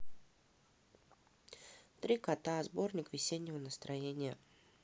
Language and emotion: Russian, neutral